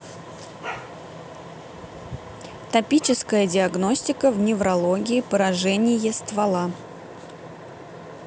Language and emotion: Russian, neutral